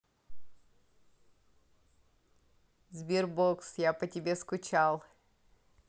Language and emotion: Russian, neutral